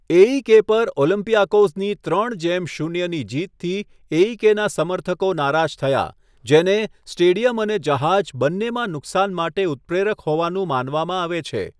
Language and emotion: Gujarati, neutral